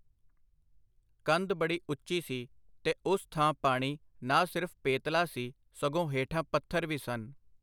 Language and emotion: Punjabi, neutral